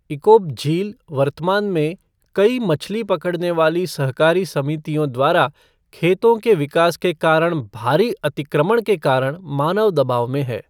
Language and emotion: Hindi, neutral